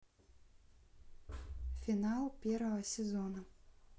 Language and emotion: Russian, neutral